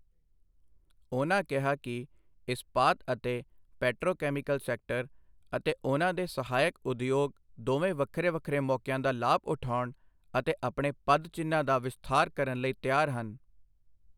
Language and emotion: Punjabi, neutral